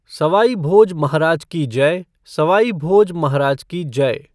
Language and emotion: Hindi, neutral